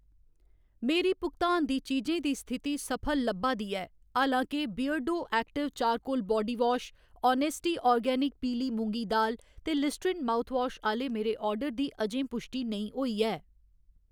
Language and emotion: Dogri, neutral